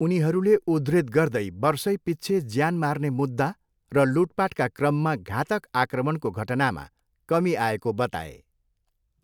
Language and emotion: Nepali, neutral